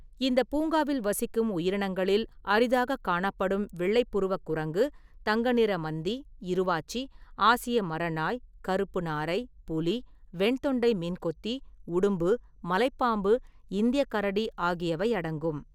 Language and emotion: Tamil, neutral